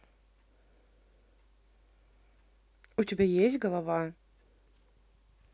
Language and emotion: Russian, neutral